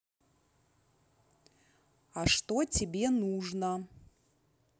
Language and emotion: Russian, neutral